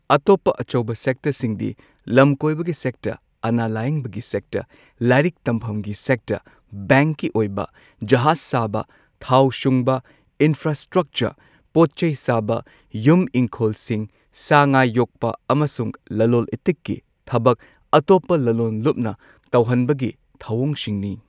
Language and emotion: Manipuri, neutral